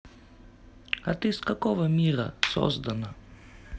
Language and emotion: Russian, neutral